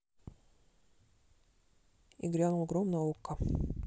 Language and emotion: Russian, neutral